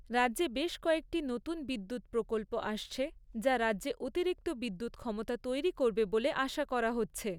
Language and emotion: Bengali, neutral